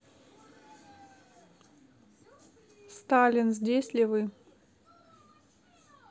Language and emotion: Russian, neutral